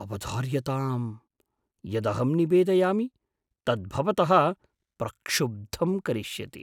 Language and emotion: Sanskrit, surprised